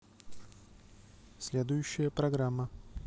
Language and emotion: Russian, neutral